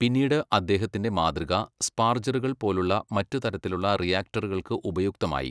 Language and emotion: Malayalam, neutral